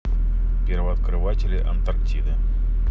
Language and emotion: Russian, neutral